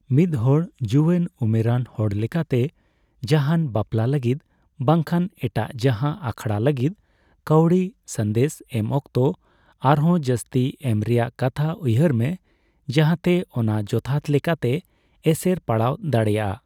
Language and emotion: Santali, neutral